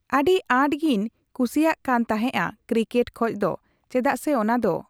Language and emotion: Santali, neutral